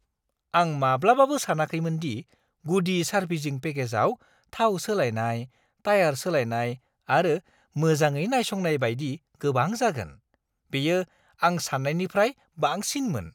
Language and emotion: Bodo, surprised